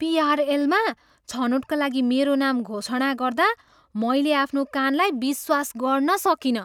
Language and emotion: Nepali, surprised